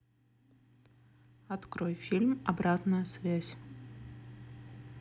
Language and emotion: Russian, neutral